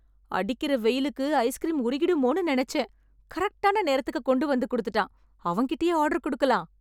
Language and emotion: Tamil, happy